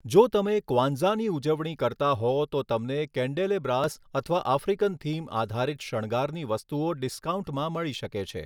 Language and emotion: Gujarati, neutral